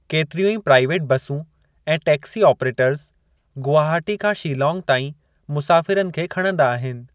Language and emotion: Sindhi, neutral